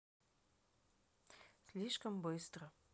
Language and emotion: Russian, neutral